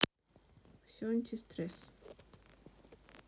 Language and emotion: Russian, neutral